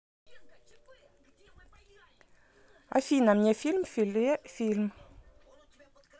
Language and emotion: Russian, neutral